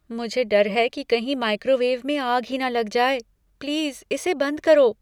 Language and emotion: Hindi, fearful